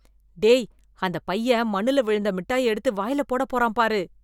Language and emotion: Tamil, disgusted